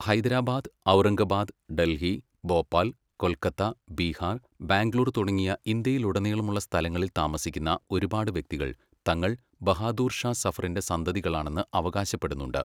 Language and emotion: Malayalam, neutral